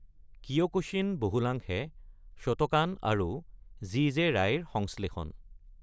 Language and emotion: Assamese, neutral